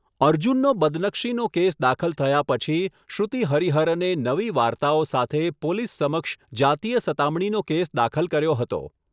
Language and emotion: Gujarati, neutral